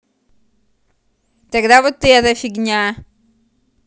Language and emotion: Russian, angry